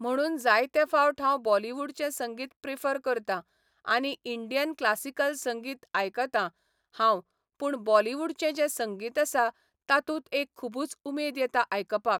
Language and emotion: Goan Konkani, neutral